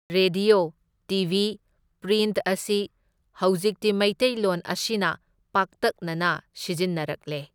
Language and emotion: Manipuri, neutral